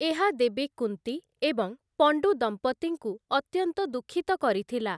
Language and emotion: Odia, neutral